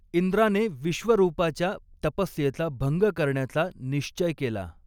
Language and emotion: Marathi, neutral